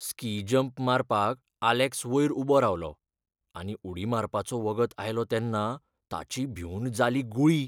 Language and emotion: Goan Konkani, fearful